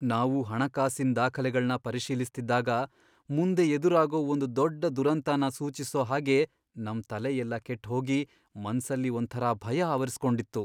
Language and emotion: Kannada, fearful